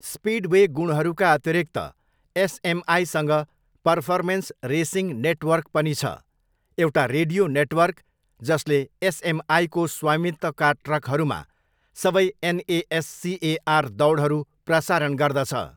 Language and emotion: Nepali, neutral